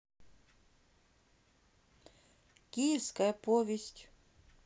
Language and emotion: Russian, neutral